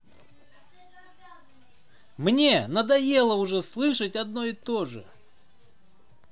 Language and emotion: Russian, positive